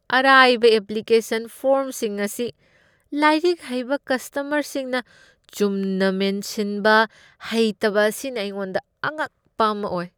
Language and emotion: Manipuri, disgusted